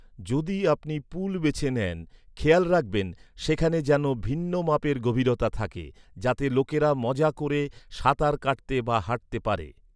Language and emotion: Bengali, neutral